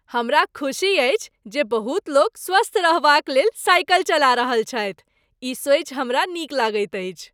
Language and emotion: Maithili, happy